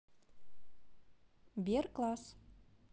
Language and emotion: Russian, neutral